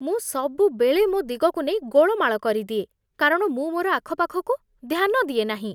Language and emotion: Odia, disgusted